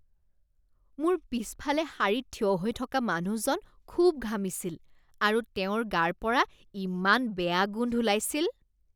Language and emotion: Assamese, disgusted